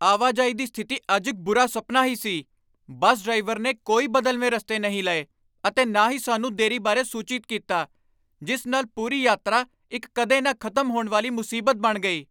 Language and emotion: Punjabi, angry